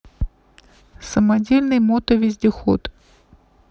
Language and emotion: Russian, neutral